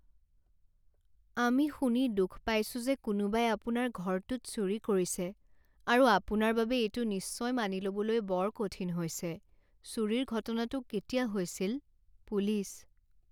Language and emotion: Assamese, sad